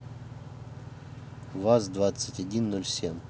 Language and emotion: Russian, neutral